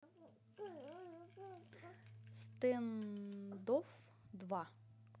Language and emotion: Russian, neutral